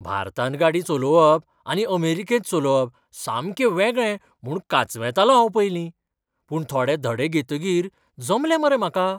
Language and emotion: Goan Konkani, surprised